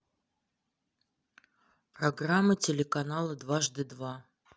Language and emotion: Russian, neutral